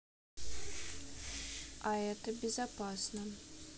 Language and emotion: Russian, neutral